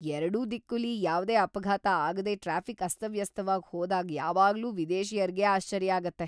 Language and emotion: Kannada, surprised